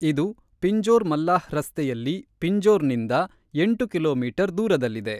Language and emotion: Kannada, neutral